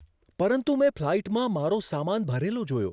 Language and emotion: Gujarati, surprised